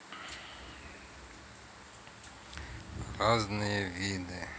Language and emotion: Russian, neutral